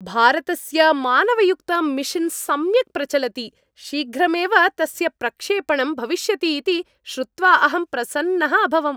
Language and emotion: Sanskrit, happy